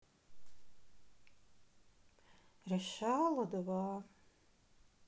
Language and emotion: Russian, sad